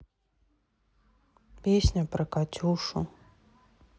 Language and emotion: Russian, sad